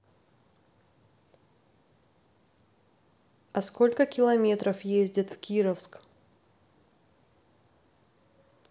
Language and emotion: Russian, neutral